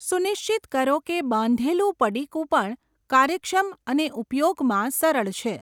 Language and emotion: Gujarati, neutral